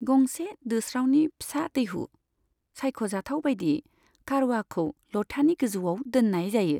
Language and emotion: Bodo, neutral